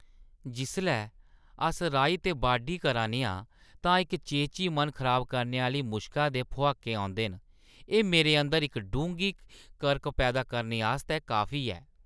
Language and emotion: Dogri, disgusted